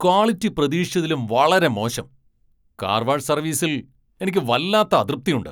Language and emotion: Malayalam, angry